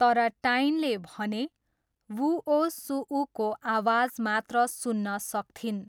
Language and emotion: Nepali, neutral